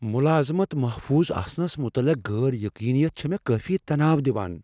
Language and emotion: Kashmiri, fearful